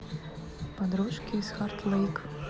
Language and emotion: Russian, neutral